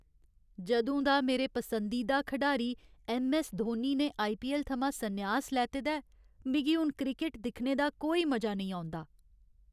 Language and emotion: Dogri, sad